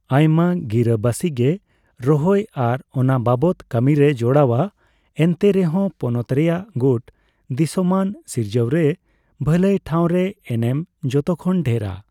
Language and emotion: Santali, neutral